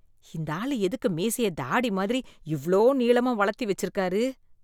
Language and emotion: Tamil, disgusted